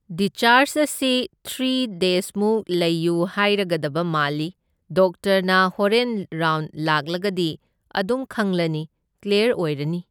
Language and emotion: Manipuri, neutral